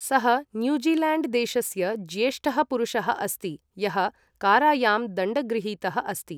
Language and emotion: Sanskrit, neutral